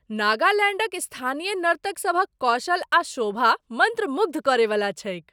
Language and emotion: Maithili, surprised